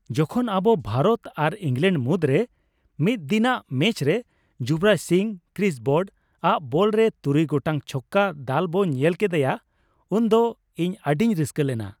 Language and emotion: Santali, happy